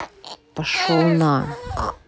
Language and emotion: Russian, angry